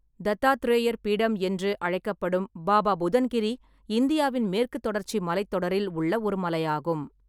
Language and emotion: Tamil, neutral